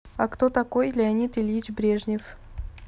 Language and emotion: Russian, neutral